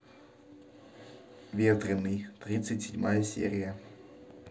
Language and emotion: Russian, neutral